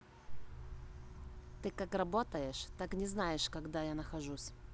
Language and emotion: Russian, angry